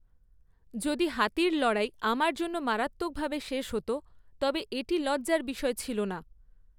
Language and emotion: Bengali, neutral